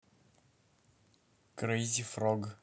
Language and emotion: Russian, neutral